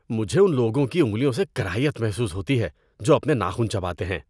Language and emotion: Urdu, disgusted